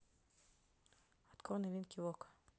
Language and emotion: Russian, neutral